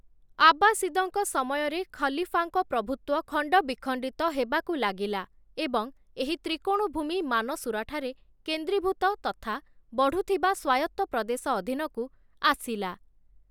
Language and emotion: Odia, neutral